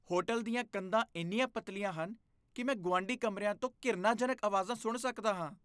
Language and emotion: Punjabi, disgusted